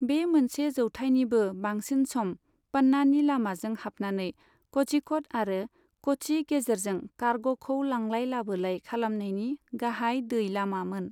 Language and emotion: Bodo, neutral